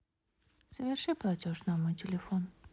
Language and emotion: Russian, neutral